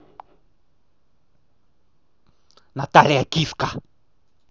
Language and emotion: Russian, angry